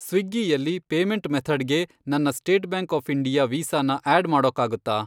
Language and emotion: Kannada, neutral